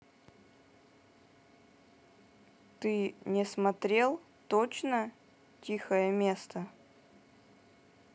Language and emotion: Russian, neutral